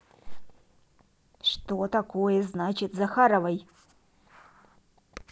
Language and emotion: Russian, neutral